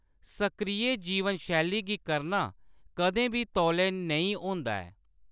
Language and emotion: Dogri, neutral